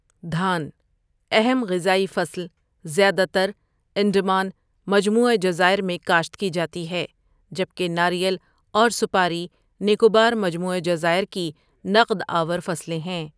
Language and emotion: Urdu, neutral